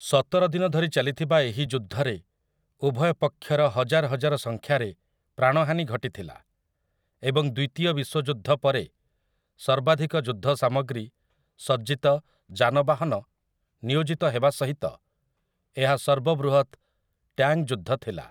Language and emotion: Odia, neutral